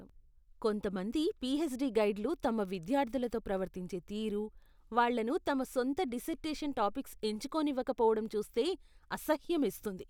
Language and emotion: Telugu, disgusted